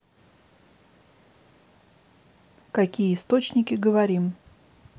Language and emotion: Russian, neutral